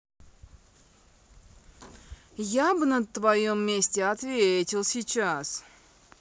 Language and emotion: Russian, angry